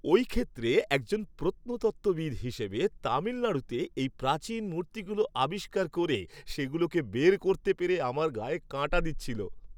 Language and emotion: Bengali, happy